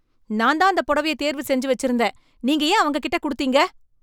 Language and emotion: Tamil, angry